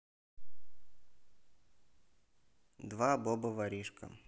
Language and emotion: Russian, neutral